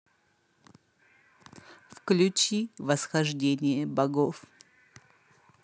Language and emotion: Russian, sad